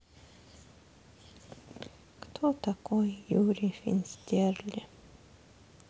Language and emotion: Russian, sad